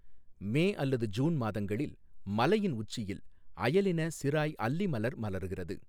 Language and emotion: Tamil, neutral